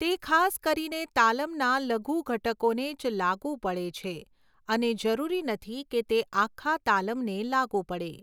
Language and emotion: Gujarati, neutral